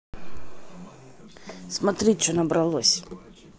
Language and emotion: Russian, neutral